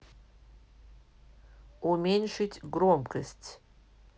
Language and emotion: Russian, neutral